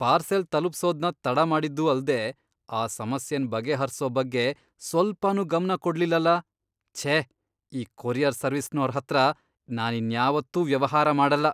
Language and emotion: Kannada, disgusted